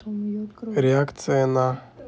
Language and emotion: Russian, neutral